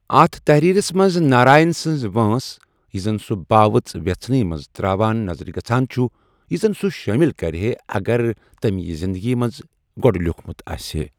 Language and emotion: Kashmiri, neutral